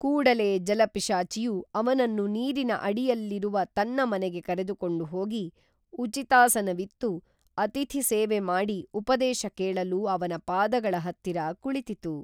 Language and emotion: Kannada, neutral